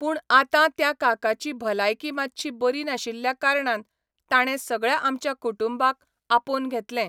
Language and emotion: Goan Konkani, neutral